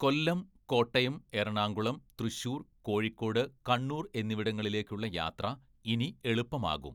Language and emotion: Malayalam, neutral